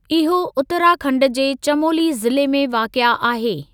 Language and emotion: Sindhi, neutral